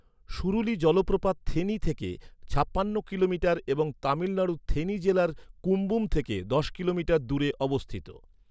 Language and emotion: Bengali, neutral